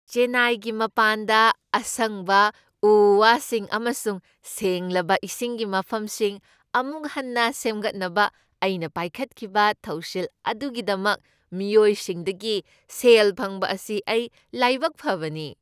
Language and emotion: Manipuri, happy